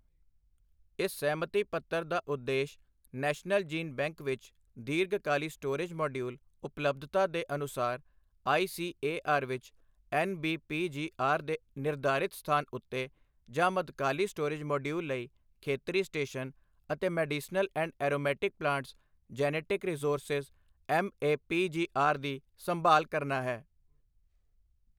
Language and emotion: Punjabi, neutral